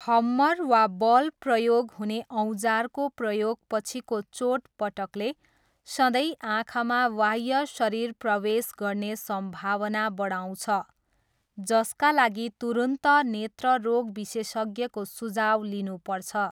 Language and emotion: Nepali, neutral